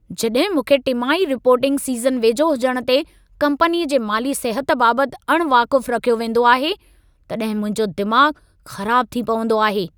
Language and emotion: Sindhi, angry